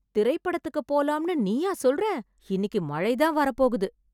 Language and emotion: Tamil, surprised